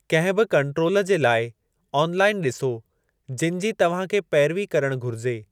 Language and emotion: Sindhi, neutral